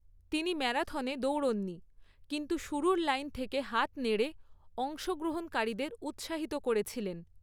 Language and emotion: Bengali, neutral